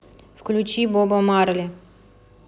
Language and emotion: Russian, neutral